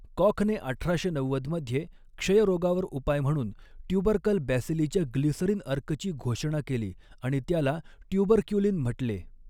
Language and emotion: Marathi, neutral